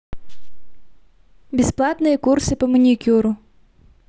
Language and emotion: Russian, neutral